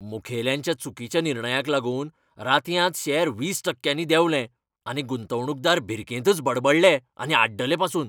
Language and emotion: Goan Konkani, angry